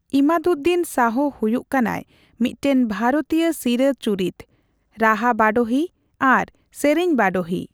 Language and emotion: Santali, neutral